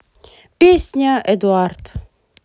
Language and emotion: Russian, positive